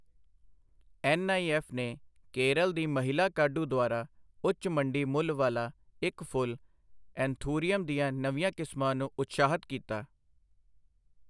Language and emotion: Punjabi, neutral